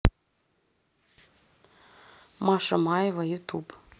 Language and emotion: Russian, neutral